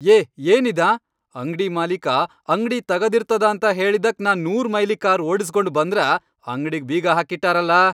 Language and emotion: Kannada, angry